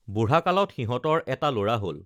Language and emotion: Assamese, neutral